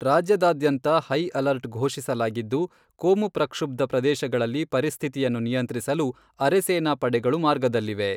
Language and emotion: Kannada, neutral